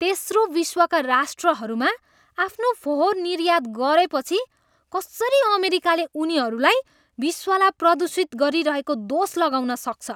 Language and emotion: Nepali, disgusted